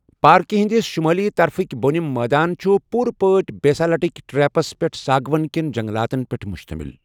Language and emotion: Kashmiri, neutral